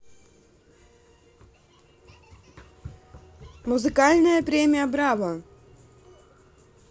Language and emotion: Russian, neutral